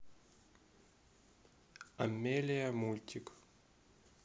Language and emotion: Russian, neutral